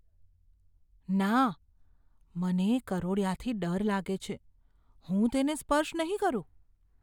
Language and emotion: Gujarati, fearful